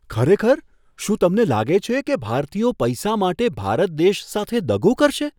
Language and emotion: Gujarati, surprised